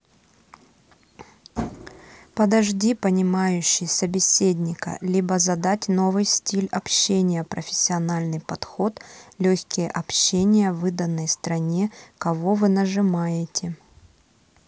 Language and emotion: Russian, neutral